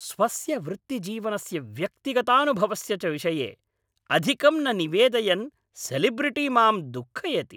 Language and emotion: Sanskrit, angry